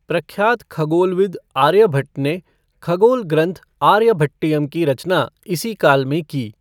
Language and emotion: Hindi, neutral